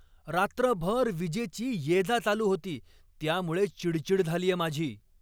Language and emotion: Marathi, angry